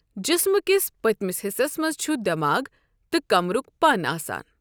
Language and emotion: Kashmiri, neutral